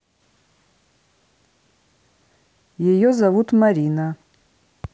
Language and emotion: Russian, neutral